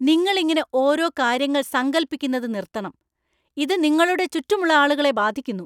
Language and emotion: Malayalam, angry